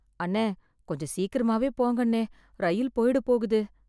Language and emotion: Tamil, sad